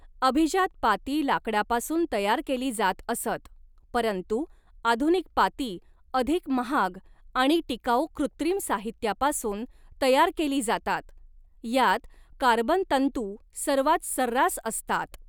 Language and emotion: Marathi, neutral